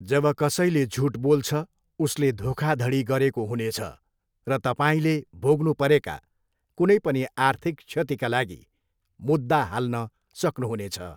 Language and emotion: Nepali, neutral